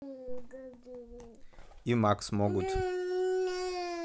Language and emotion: Russian, neutral